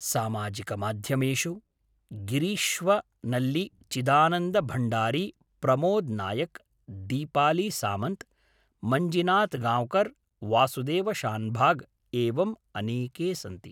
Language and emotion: Sanskrit, neutral